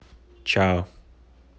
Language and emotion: Russian, neutral